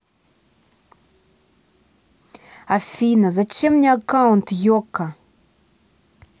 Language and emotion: Russian, angry